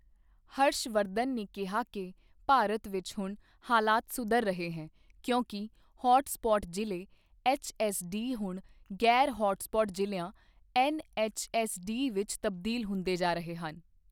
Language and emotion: Punjabi, neutral